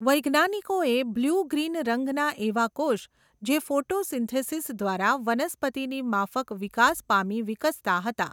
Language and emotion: Gujarati, neutral